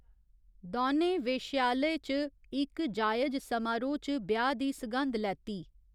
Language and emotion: Dogri, neutral